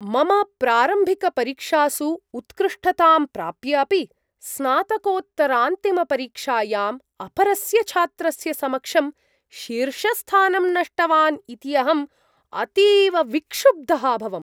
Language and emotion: Sanskrit, surprised